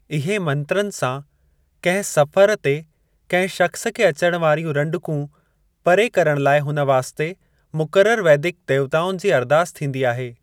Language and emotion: Sindhi, neutral